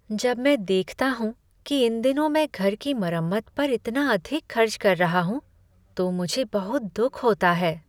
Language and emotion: Hindi, sad